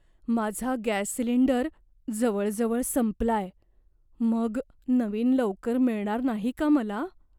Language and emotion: Marathi, fearful